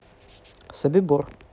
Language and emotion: Russian, neutral